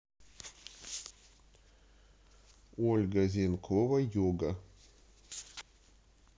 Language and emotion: Russian, neutral